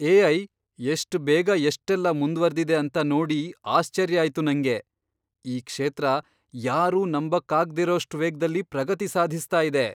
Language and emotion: Kannada, surprised